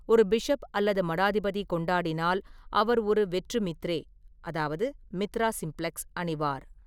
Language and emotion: Tamil, neutral